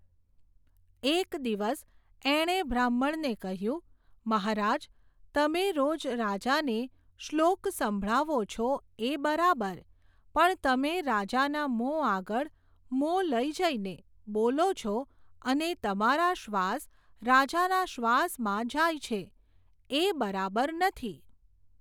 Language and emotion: Gujarati, neutral